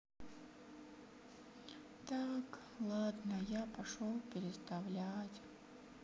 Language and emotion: Russian, sad